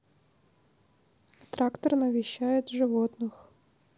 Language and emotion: Russian, neutral